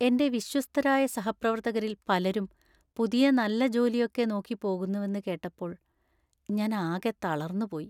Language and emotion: Malayalam, sad